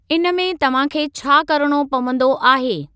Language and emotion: Sindhi, neutral